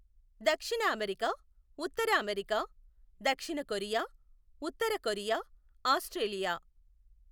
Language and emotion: Telugu, neutral